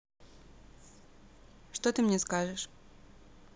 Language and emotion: Russian, neutral